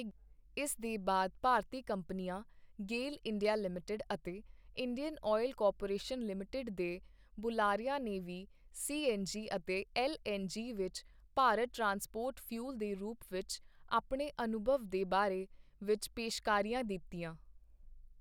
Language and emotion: Punjabi, neutral